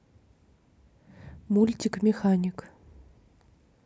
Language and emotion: Russian, neutral